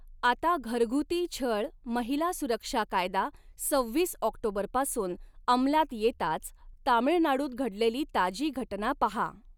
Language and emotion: Marathi, neutral